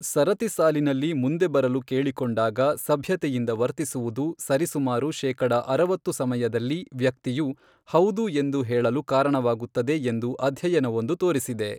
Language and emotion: Kannada, neutral